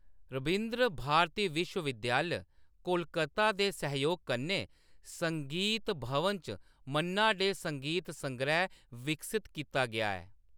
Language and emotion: Dogri, neutral